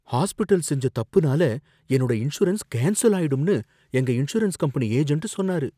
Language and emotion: Tamil, fearful